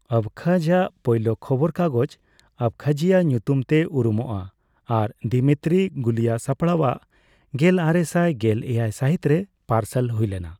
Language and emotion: Santali, neutral